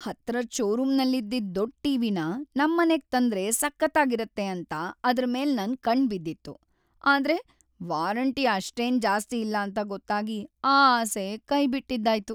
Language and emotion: Kannada, sad